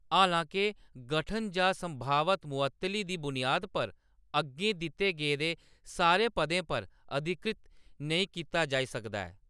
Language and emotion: Dogri, neutral